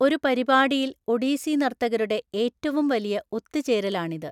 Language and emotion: Malayalam, neutral